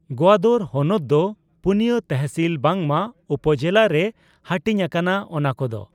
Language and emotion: Santali, neutral